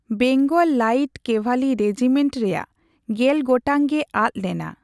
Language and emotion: Santali, neutral